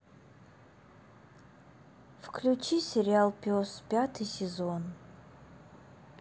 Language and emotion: Russian, sad